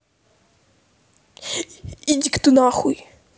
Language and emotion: Russian, angry